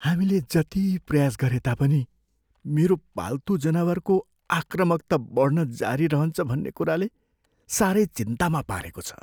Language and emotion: Nepali, fearful